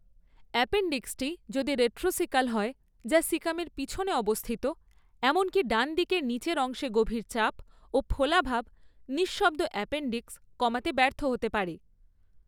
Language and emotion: Bengali, neutral